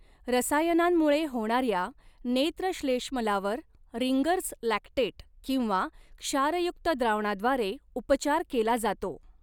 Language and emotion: Marathi, neutral